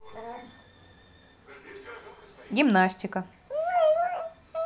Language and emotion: Russian, neutral